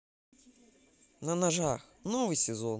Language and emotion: Russian, positive